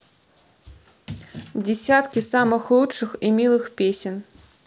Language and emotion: Russian, neutral